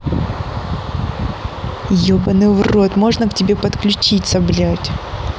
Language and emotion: Russian, angry